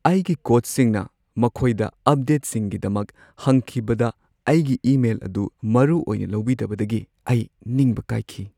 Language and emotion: Manipuri, sad